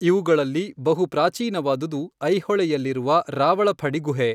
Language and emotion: Kannada, neutral